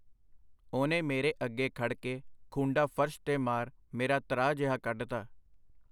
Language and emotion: Punjabi, neutral